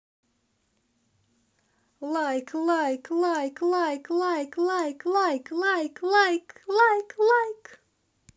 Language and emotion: Russian, positive